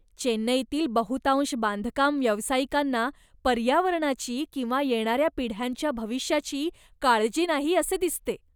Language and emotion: Marathi, disgusted